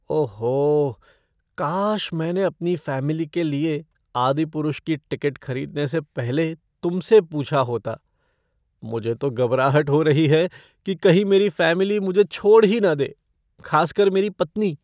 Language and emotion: Hindi, fearful